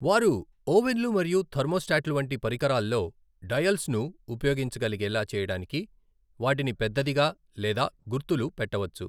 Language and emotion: Telugu, neutral